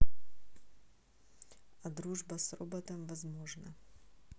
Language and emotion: Russian, neutral